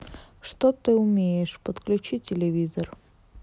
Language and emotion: Russian, neutral